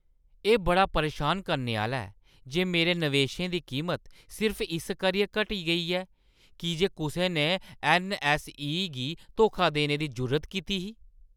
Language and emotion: Dogri, angry